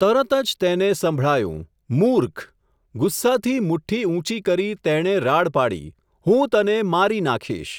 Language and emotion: Gujarati, neutral